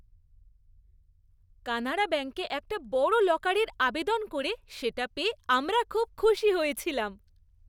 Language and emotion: Bengali, happy